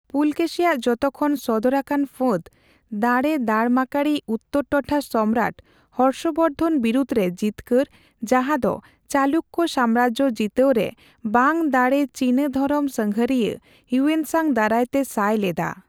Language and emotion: Santali, neutral